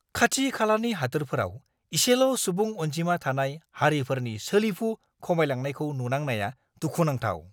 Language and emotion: Bodo, angry